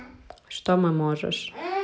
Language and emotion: Russian, neutral